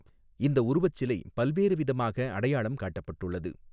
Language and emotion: Tamil, neutral